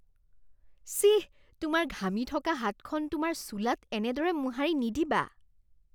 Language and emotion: Assamese, disgusted